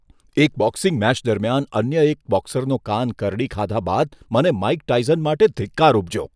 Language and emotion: Gujarati, disgusted